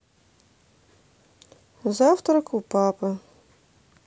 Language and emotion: Russian, neutral